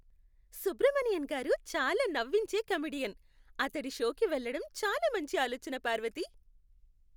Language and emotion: Telugu, happy